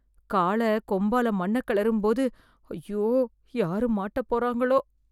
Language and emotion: Tamil, fearful